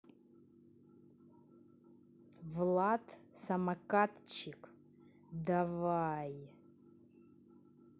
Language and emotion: Russian, angry